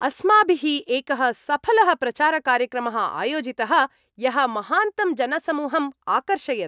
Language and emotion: Sanskrit, happy